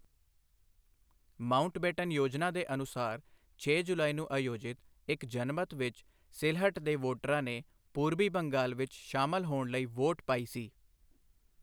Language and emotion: Punjabi, neutral